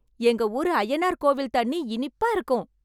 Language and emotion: Tamil, happy